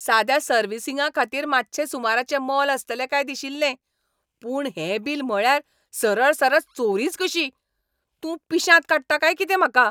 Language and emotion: Goan Konkani, angry